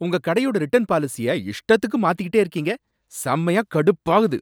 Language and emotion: Tamil, angry